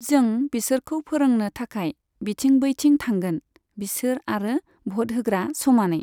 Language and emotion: Bodo, neutral